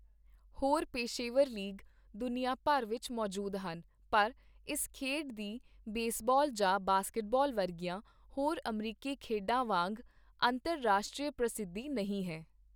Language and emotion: Punjabi, neutral